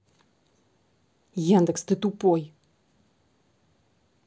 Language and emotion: Russian, angry